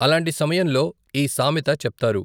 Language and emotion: Telugu, neutral